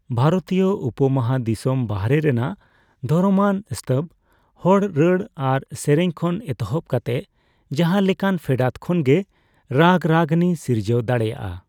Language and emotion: Santali, neutral